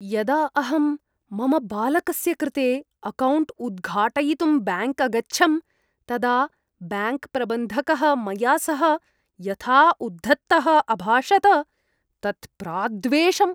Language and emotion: Sanskrit, disgusted